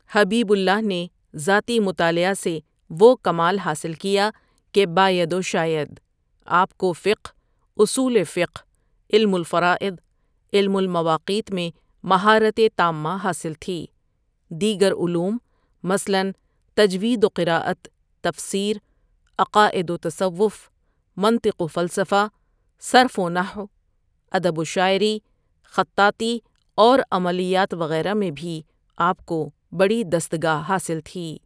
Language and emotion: Urdu, neutral